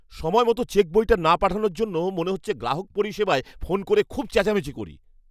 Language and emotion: Bengali, angry